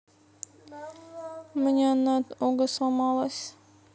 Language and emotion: Russian, sad